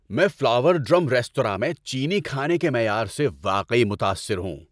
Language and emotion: Urdu, happy